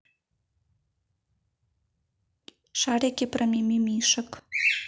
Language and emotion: Russian, neutral